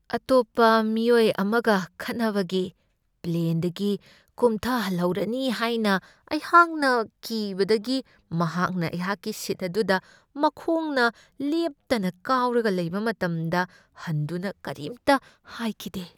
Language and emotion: Manipuri, fearful